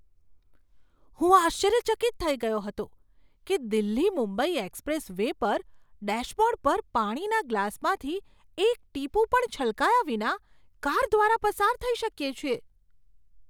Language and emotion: Gujarati, surprised